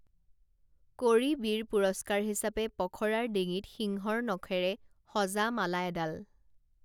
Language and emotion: Assamese, neutral